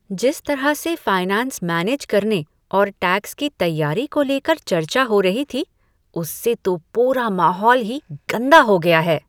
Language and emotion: Hindi, disgusted